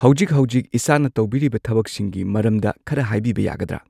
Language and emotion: Manipuri, neutral